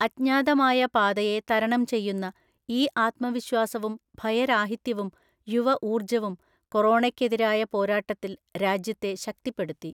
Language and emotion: Malayalam, neutral